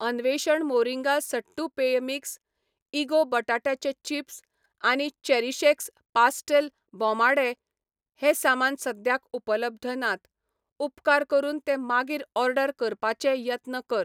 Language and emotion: Goan Konkani, neutral